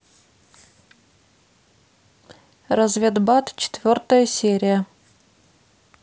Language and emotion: Russian, neutral